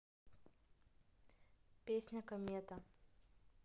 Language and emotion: Russian, neutral